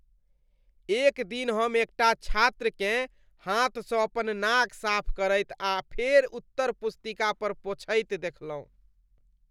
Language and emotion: Maithili, disgusted